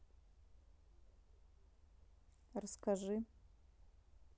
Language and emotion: Russian, neutral